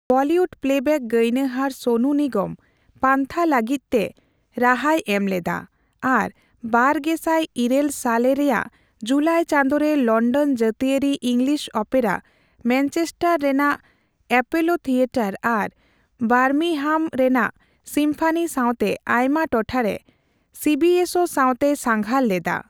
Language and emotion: Santali, neutral